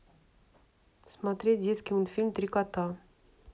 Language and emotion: Russian, neutral